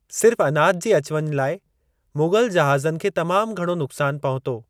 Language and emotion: Sindhi, neutral